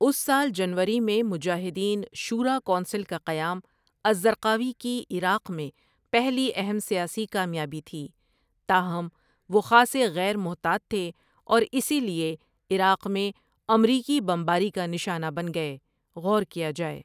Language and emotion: Urdu, neutral